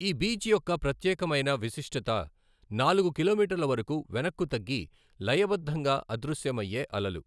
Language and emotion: Telugu, neutral